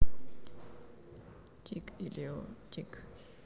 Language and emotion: Russian, neutral